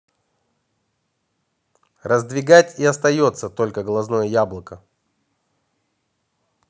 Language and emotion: Russian, neutral